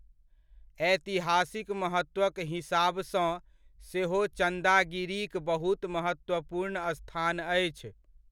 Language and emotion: Maithili, neutral